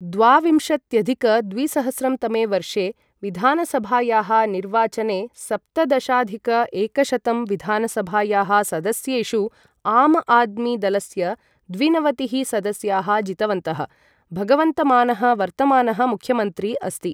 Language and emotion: Sanskrit, neutral